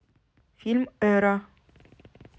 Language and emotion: Russian, neutral